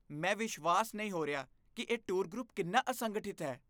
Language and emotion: Punjabi, disgusted